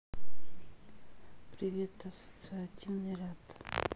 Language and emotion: Russian, sad